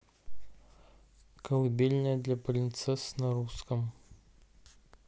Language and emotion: Russian, neutral